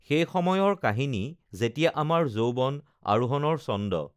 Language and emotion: Assamese, neutral